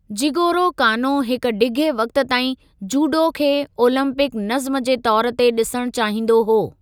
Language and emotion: Sindhi, neutral